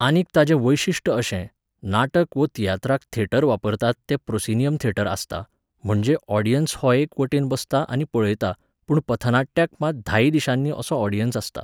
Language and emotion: Goan Konkani, neutral